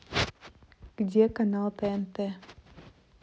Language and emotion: Russian, neutral